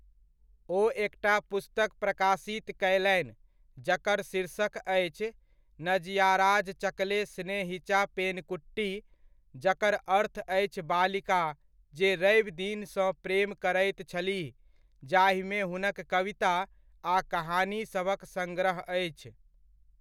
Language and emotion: Maithili, neutral